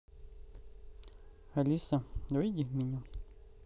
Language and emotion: Russian, neutral